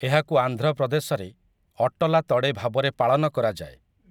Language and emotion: Odia, neutral